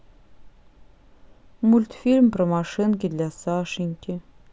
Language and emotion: Russian, neutral